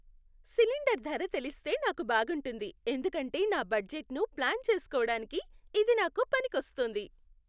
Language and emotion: Telugu, happy